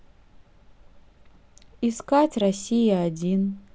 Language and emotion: Russian, neutral